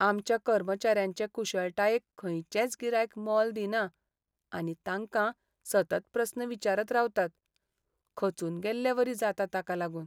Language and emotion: Goan Konkani, sad